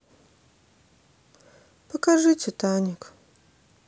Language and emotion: Russian, sad